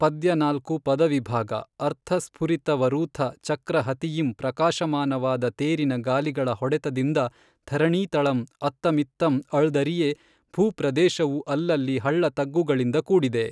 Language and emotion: Kannada, neutral